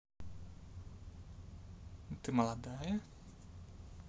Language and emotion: Russian, neutral